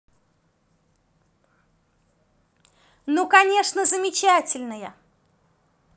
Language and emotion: Russian, positive